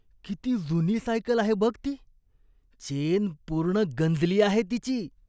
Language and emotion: Marathi, disgusted